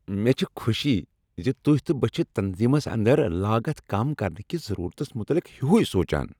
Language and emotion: Kashmiri, happy